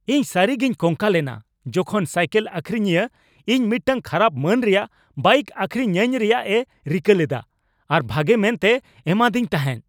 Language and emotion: Santali, angry